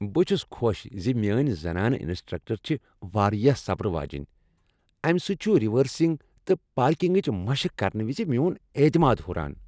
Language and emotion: Kashmiri, happy